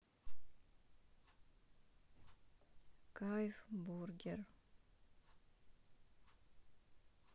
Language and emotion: Russian, sad